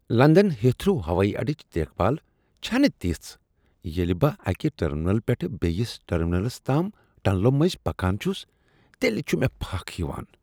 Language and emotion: Kashmiri, disgusted